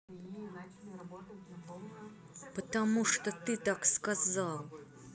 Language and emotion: Russian, angry